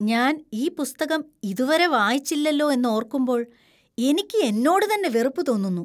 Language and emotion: Malayalam, disgusted